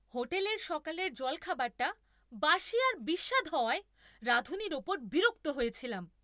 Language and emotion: Bengali, angry